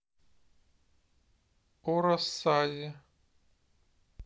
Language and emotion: Russian, neutral